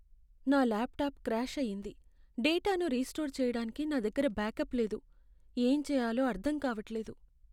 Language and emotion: Telugu, sad